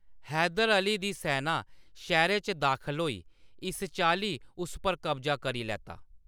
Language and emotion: Dogri, neutral